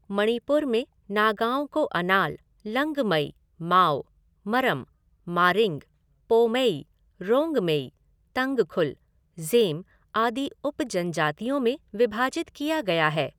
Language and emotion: Hindi, neutral